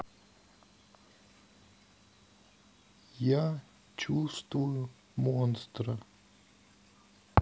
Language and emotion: Russian, sad